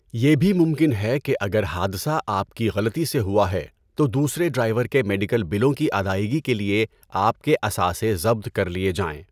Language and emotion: Urdu, neutral